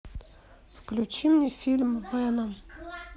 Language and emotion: Russian, sad